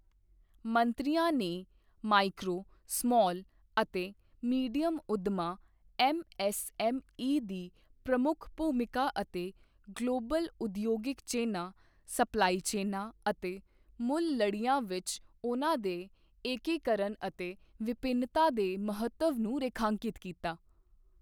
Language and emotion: Punjabi, neutral